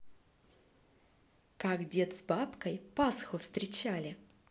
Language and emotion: Russian, positive